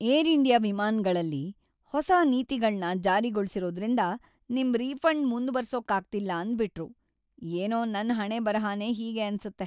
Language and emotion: Kannada, sad